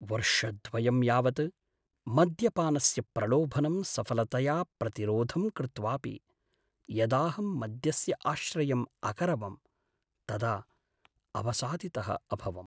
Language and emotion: Sanskrit, sad